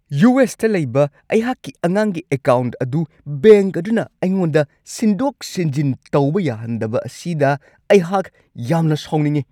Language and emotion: Manipuri, angry